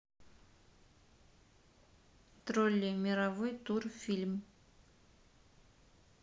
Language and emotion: Russian, neutral